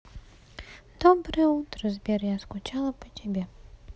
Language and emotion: Russian, sad